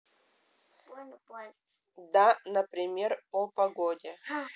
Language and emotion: Russian, neutral